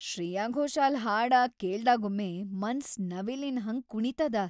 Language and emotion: Kannada, happy